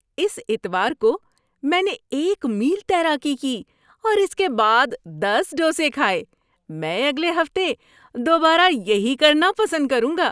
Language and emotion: Urdu, happy